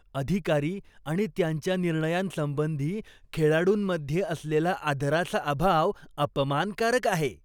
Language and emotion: Marathi, disgusted